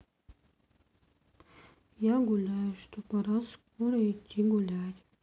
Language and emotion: Russian, sad